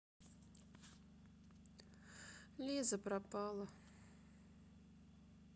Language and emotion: Russian, sad